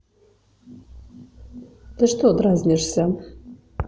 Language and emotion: Russian, neutral